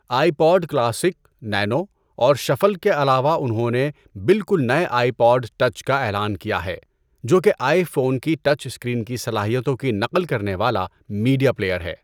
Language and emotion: Urdu, neutral